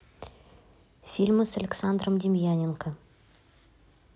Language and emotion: Russian, neutral